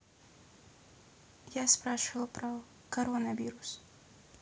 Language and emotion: Russian, neutral